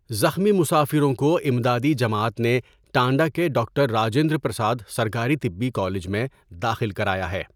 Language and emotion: Urdu, neutral